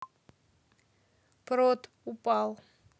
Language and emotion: Russian, neutral